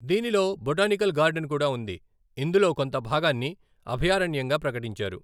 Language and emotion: Telugu, neutral